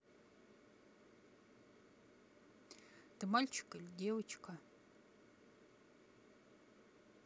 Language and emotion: Russian, neutral